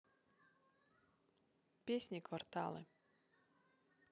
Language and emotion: Russian, neutral